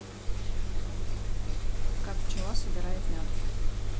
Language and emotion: Russian, neutral